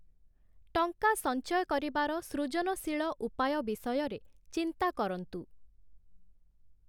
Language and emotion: Odia, neutral